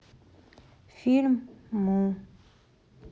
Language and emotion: Russian, sad